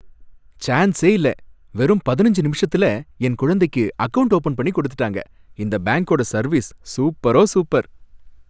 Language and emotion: Tamil, happy